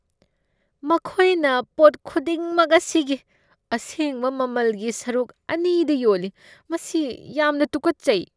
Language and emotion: Manipuri, disgusted